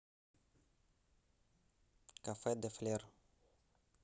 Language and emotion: Russian, neutral